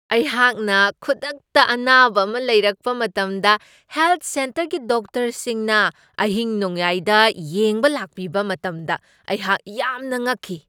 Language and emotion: Manipuri, surprised